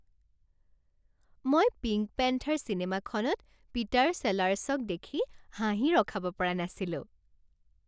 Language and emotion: Assamese, happy